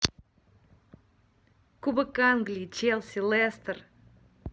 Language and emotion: Russian, neutral